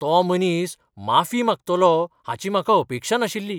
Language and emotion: Goan Konkani, surprised